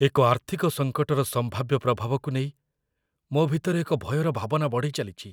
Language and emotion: Odia, fearful